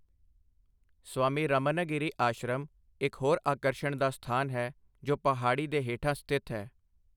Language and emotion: Punjabi, neutral